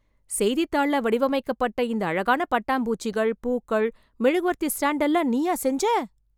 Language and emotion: Tamil, surprised